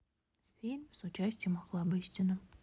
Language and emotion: Russian, neutral